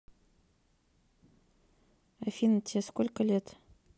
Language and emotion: Russian, neutral